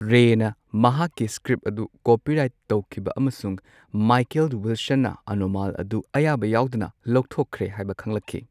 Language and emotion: Manipuri, neutral